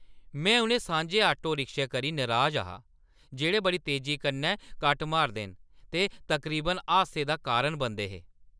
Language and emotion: Dogri, angry